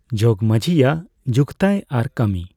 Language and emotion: Santali, neutral